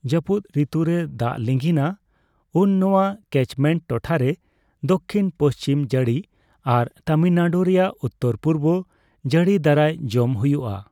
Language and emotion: Santali, neutral